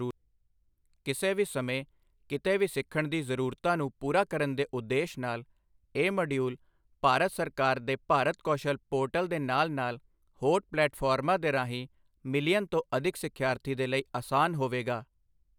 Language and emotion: Punjabi, neutral